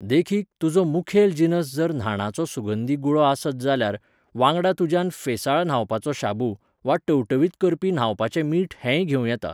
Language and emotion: Goan Konkani, neutral